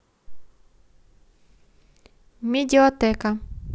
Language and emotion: Russian, neutral